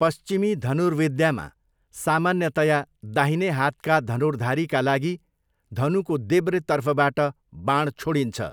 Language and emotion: Nepali, neutral